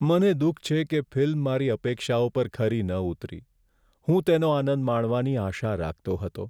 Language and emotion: Gujarati, sad